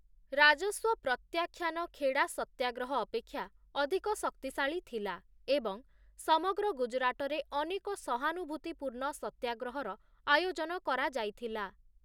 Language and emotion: Odia, neutral